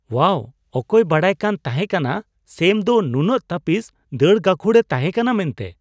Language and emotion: Santali, surprised